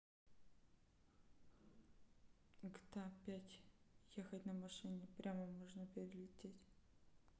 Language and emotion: Russian, neutral